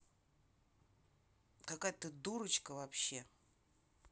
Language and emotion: Russian, angry